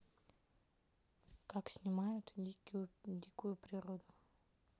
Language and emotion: Russian, neutral